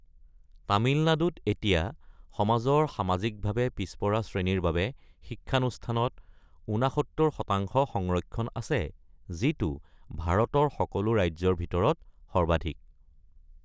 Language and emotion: Assamese, neutral